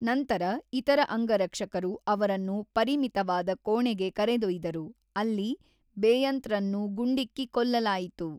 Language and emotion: Kannada, neutral